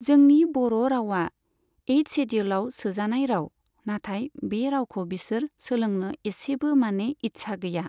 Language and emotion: Bodo, neutral